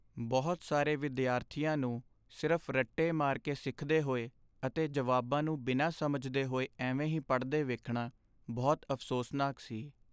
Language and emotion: Punjabi, sad